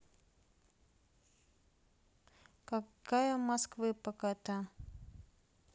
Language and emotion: Russian, neutral